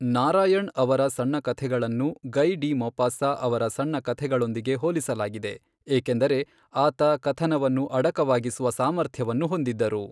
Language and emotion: Kannada, neutral